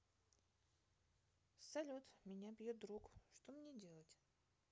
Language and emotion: Russian, neutral